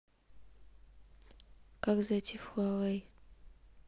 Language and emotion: Russian, neutral